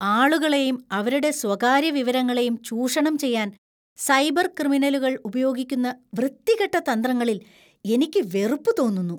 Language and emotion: Malayalam, disgusted